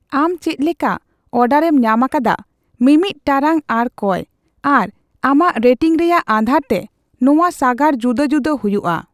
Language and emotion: Santali, neutral